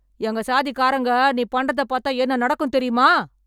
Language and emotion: Tamil, angry